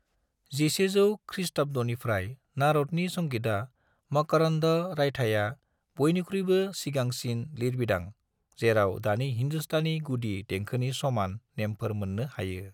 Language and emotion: Bodo, neutral